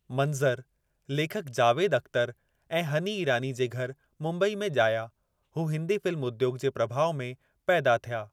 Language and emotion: Sindhi, neutral